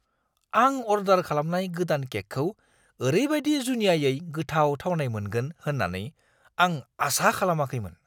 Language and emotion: Bodo, surprised